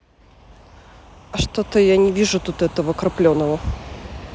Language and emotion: Russian, neutral